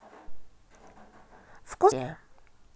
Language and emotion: Russian, positive